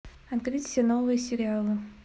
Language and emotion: Russian, neutral